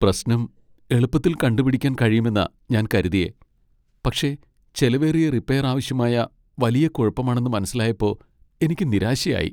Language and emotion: Malayalam, sad